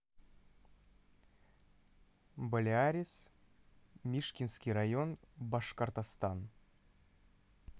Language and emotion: Russian, neutral